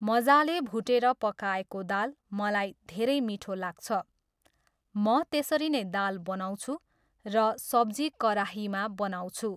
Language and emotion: Nepali, neutral